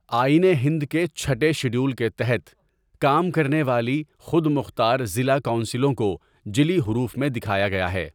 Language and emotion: Urdu, neutral